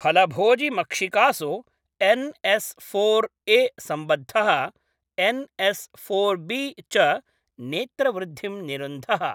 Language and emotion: Sanskrit, neutral